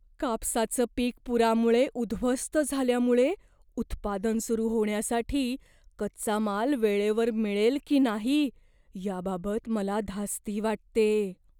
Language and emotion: Marathi, fearful